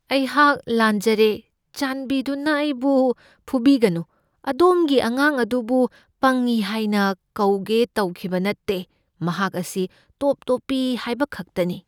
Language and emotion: Manipuri, fearful